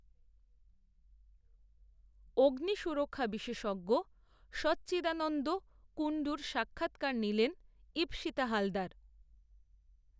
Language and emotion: Bengali, neutral